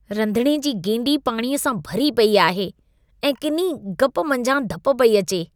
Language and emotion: Sindhi, disgusted